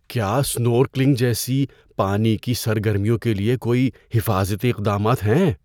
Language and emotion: Urdu, fearful